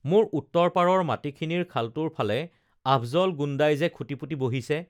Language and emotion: Assamese, neutral